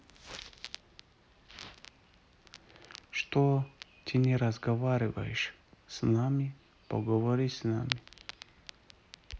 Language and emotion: Russian, neutral